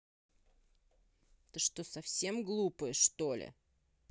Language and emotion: Russian, angry